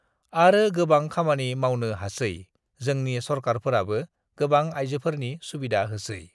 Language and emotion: Bodo, neutral